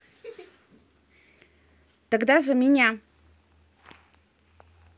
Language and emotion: Russian, positive